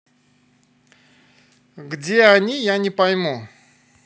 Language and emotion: Russian, angry